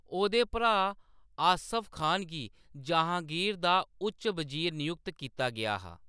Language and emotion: Dogri, neutral